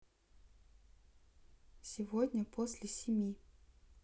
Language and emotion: Russian, neutral